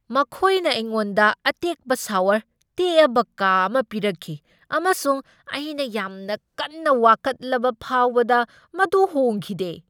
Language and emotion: Manipuri, angry